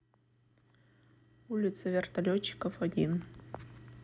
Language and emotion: Russian, neutral